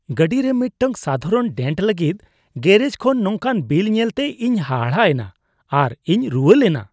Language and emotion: Santali, disgusted